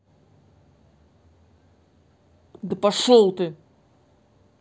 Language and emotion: Russian, angry